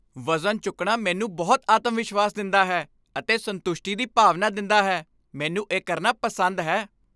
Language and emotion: Punjabi, happy